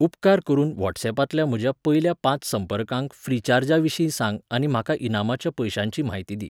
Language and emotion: Goan Konkani, neutral